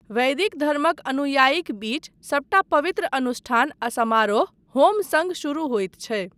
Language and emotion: Maithili, neutral